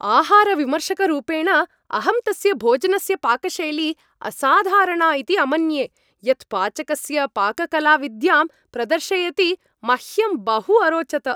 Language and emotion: Sanskrit, happy